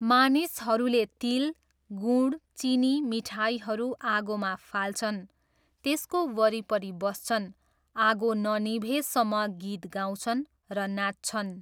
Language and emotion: Nepali, neutral